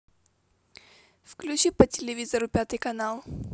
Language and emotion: Russian, neutral